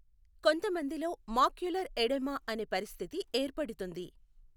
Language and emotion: Telugu, neutral